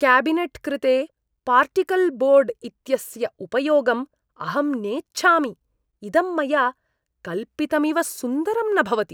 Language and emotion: Sanskrit, disgusted